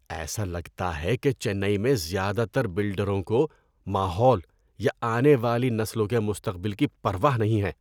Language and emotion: Urdu, disgusted